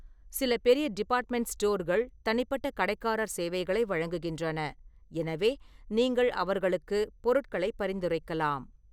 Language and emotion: Tamil, neutral